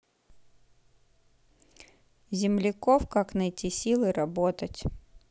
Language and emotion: Russian, neutral